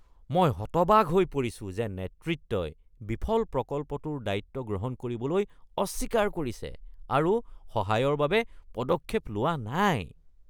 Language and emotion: Assamese, disgusted